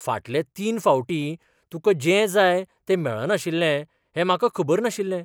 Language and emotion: Goan Konkani, surprised